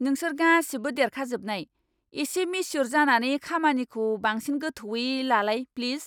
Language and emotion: Bodo, angry